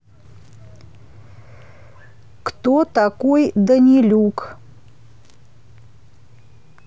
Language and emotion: Russian, neutral